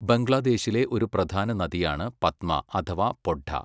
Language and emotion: Malayalam, neutral